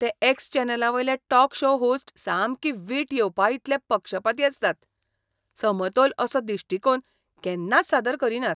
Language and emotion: Goan Konkani, disgusted